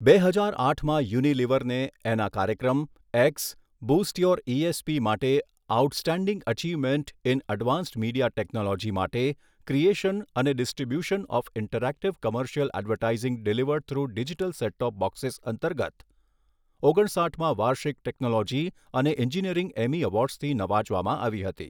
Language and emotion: Gujarati, neutral